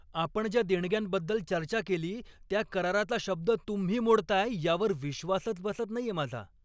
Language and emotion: Marathi, angry